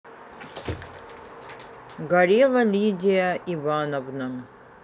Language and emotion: Russian, neutral